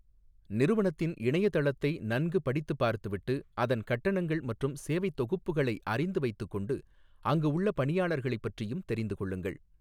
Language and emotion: Tamil, neutral